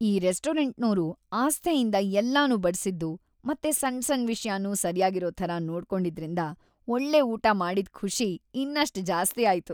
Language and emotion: Kannada, happy